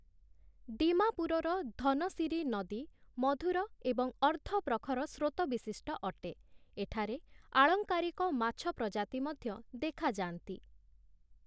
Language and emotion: Odia, neutral